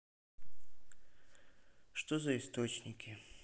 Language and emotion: Russian, sad